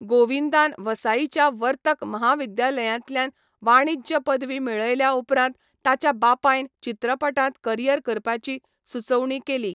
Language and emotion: Goan Konkani, neutral